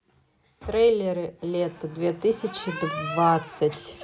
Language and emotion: Russian, neutral